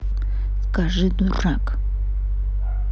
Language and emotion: Russian, angry